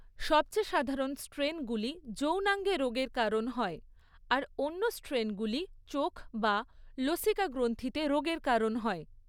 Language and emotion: Bengali, neutral